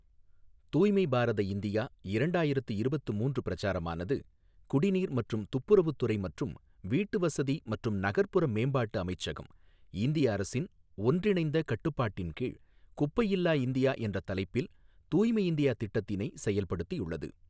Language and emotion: Tamil, neutral